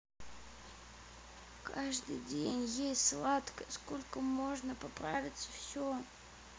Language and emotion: Russian, sad